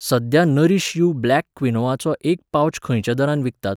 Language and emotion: Goan Konkani, neutral